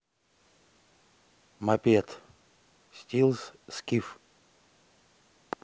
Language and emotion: Russian, neutral